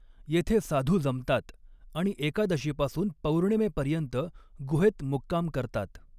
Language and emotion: Marathi, neutral